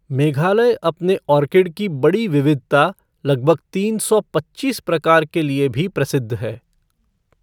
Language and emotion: Hindi, neutral